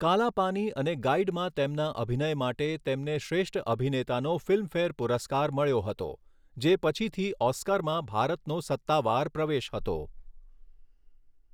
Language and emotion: Gujarati, neutral